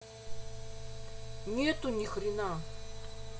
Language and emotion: Russian, angry